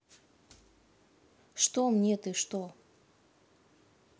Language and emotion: Russian, neutral